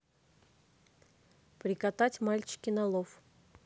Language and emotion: Russian, neutral